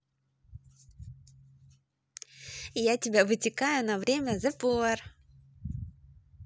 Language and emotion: Russian, positive